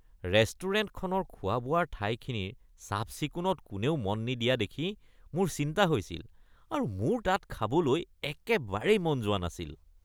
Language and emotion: Assamese, disgusted